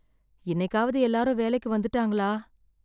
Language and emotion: Tamil, sad